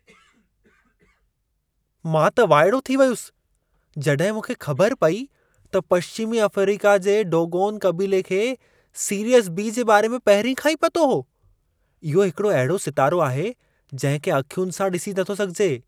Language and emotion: Sindhi, surprised